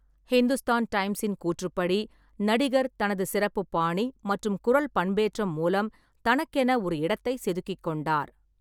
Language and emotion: Tamil, neutral